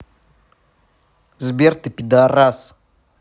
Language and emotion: Russian, angry